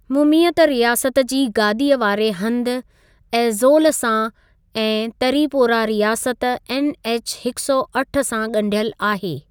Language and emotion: Sindhi, neutral